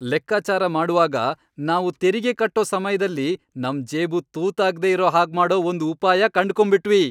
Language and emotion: Kannada, happy